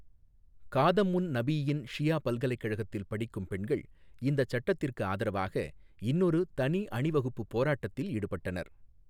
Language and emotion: Tamil, neutral